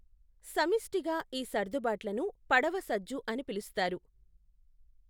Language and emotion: Telugu, neutral